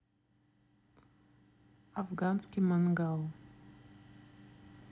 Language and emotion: Russian, neutral